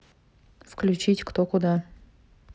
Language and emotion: Russian, neutral